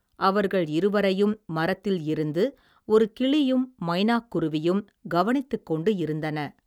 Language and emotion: Tamil, neutral